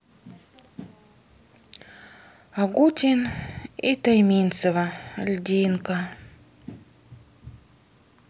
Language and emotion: Russian, sad